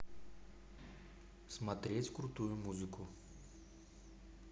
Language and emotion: Russian, neutral